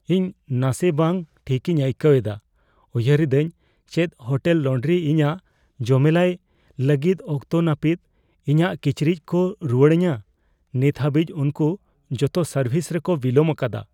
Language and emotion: Santali, fearful